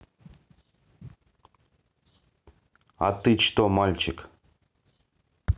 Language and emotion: Russian, neutral